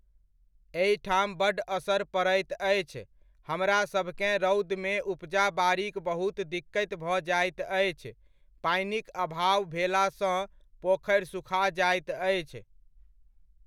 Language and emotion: Maithili, neutral